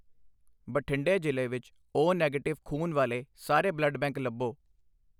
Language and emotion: Punjabi, neutral